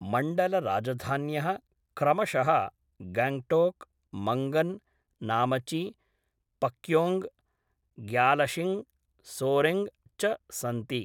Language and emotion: Sanskrit, neutral